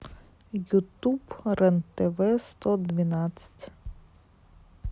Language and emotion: Russian, neutral